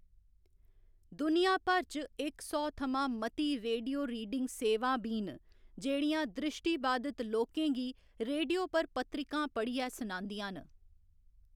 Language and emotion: Dogri, neutral